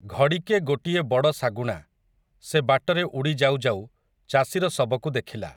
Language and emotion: Odia, neutral